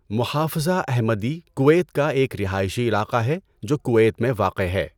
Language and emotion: Urdu, neutral